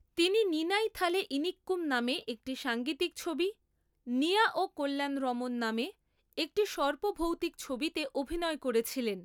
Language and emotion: Bengali, neutral